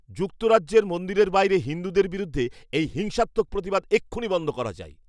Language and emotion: Bengali, angry